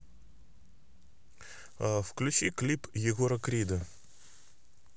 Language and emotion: Russian, neutral